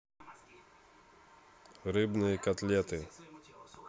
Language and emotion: Russian, neutral